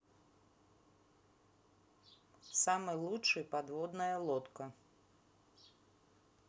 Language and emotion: Russian, neutral